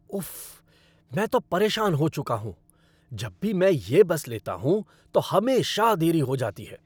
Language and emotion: Hindi, angry